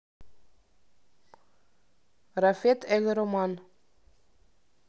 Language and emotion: Russian, neutral